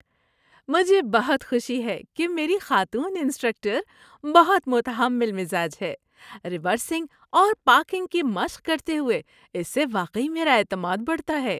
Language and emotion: Urdu, happy